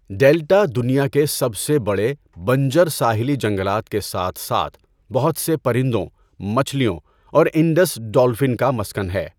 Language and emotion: Urdu, neutral